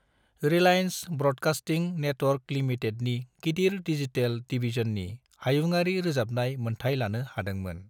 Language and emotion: Bodo, neutral